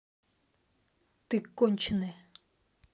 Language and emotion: Russian, angry